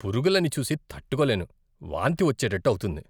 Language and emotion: Telugu, disgusted